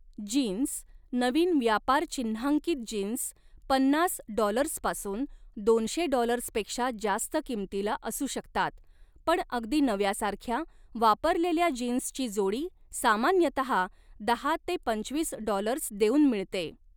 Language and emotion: Marathi, neutral